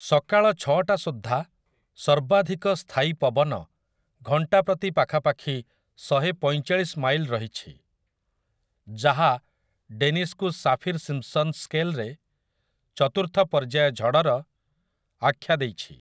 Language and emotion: Odia, neutral